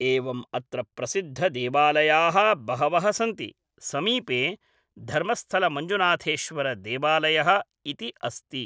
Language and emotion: Sanskrit, neutral